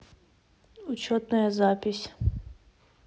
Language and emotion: Russian, neutral